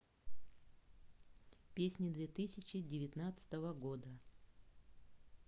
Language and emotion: Russian, neutral